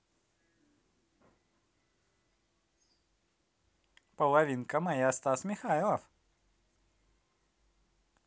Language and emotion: Russian, positive